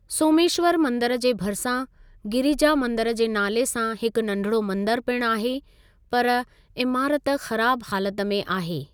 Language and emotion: Sindhi, neutral